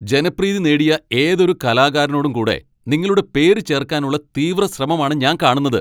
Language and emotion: Malayalam, angry